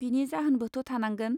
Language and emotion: Bodo, neutral